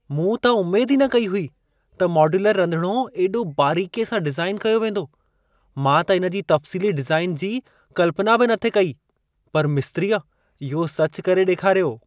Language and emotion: Sindhi, surprised